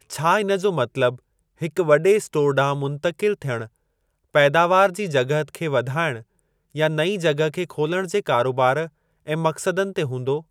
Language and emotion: Sindhi, neutral